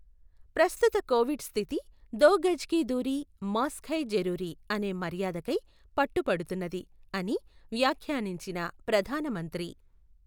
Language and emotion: Telugu, neutral